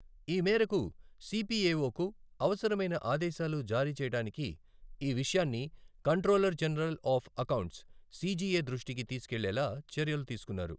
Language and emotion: Telugu, neutral